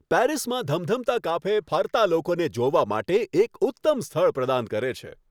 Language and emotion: Gujarati, happy